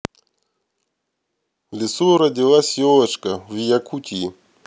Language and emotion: Russian, neutral